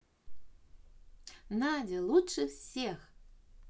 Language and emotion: Russian, positive